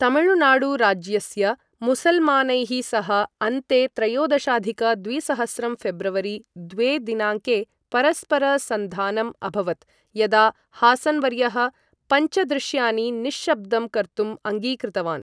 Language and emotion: Sanskrit, neutral